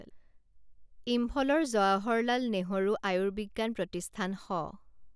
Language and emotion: Assamese, neutral